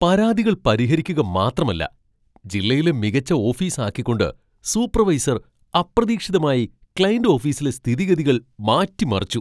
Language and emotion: Malayalam, surprised